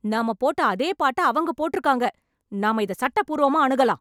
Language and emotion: Tamil, angry